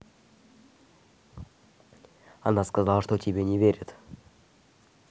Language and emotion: Russian, neutral